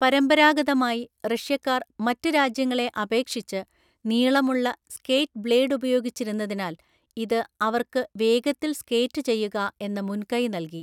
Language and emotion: Malayalam, neutral